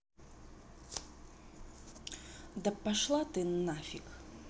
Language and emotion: Russian, angry